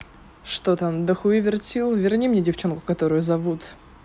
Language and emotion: Russian, neutral